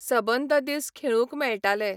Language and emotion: Goan Konkani, neutral